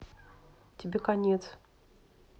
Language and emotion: Russian, neutral